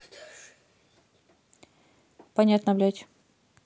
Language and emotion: Russian, neutral